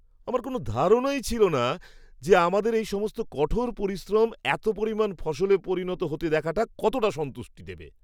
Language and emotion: Bengali, surprised